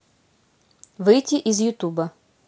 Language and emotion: Russian, neutral